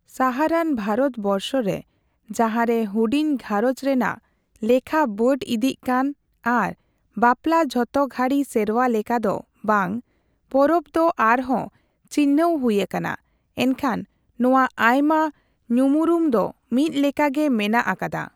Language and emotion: Santali, neutral